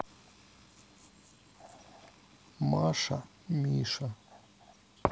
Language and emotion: Russian, sad